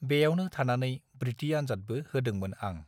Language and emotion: Bodo, neutral